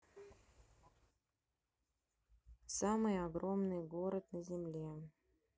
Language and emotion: Russian, neutral